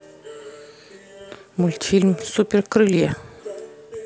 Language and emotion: Russian, neutral